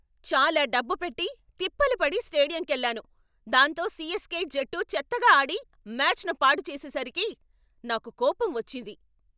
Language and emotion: Telugu, angry